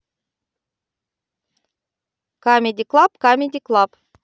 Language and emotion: Russian, positive